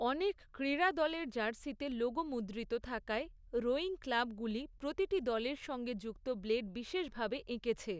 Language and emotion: Bengali, neutral